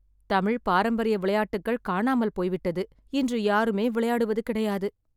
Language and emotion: Tamil, sad